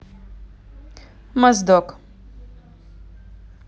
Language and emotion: Russian, neutral